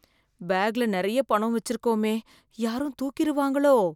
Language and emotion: Tamil, fearful